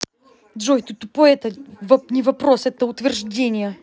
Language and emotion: Russian, angry